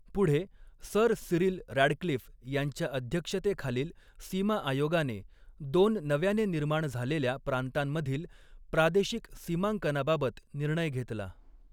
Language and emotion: Marathi, neutral